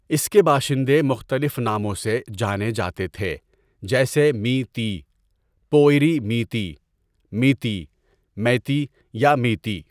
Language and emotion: Urdu, neutral